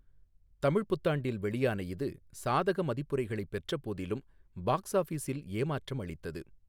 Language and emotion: Tamil, neutral